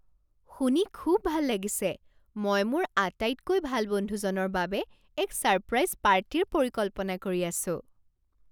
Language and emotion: Assamese, surprised